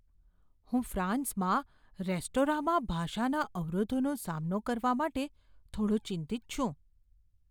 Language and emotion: Gujarati, fearful